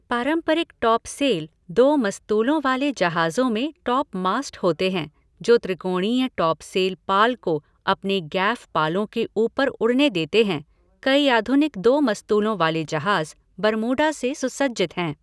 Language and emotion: Hindi, neutral